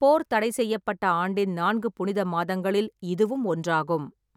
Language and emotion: Tamil, neutral